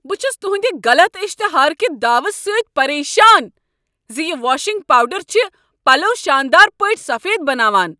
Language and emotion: Kashmiri, angry